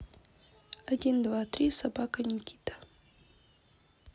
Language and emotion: Russian, neutral